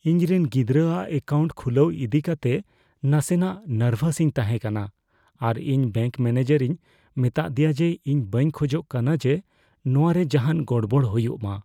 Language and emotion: Santali, fearful